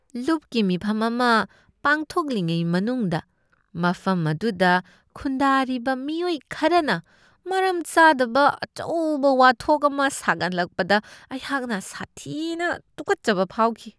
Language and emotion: Manipuri, disgusted